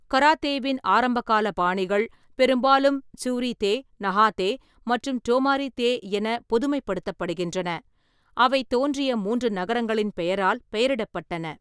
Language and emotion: Tamil, neutral